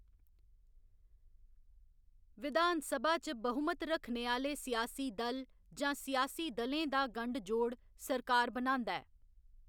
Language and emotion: Dogri, neutral